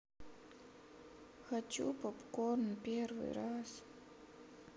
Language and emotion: Russian, sad